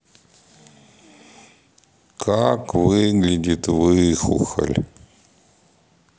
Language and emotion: Russian, sad